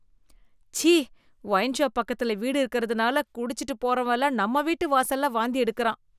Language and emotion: Tamil, disgusted